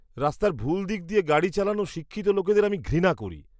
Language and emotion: Bengali, disgusted